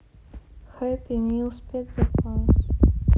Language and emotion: Russian, sad